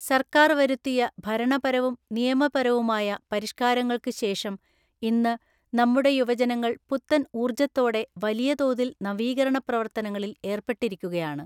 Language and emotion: Malayalam, neutral